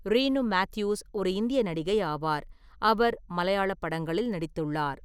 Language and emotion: Tamil, neutral